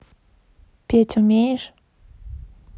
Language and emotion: Russian, neutral